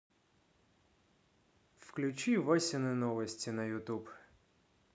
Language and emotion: Russian, neutral